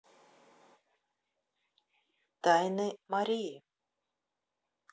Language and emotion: Russian, neutral